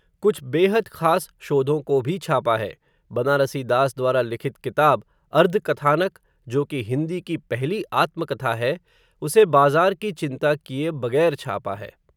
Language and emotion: Hindi, neutral